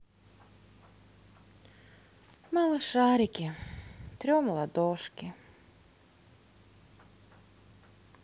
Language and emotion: Russian, sad